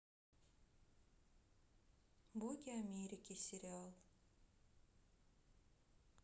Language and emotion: Russian, sad